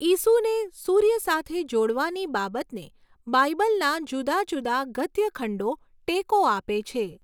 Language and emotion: Gujarati, neutral